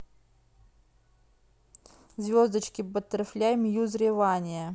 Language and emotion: Russian, neutral